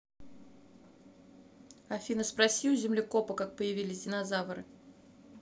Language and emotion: Russian, neutral